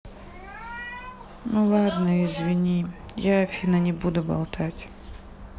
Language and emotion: Russian, sad